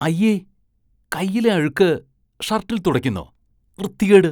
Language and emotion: Malayalam, disgusted